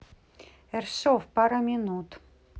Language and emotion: Russian, neutral